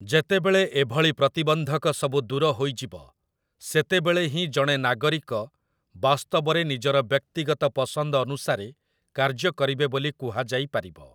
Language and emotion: Odia, neutral